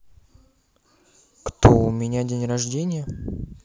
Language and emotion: Russian, neutral